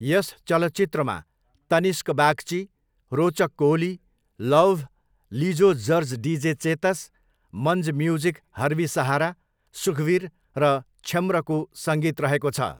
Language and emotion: Nepali, neutral